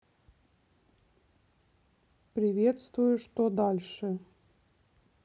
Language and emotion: Russian, neutral